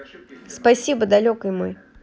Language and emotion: Russian, neutral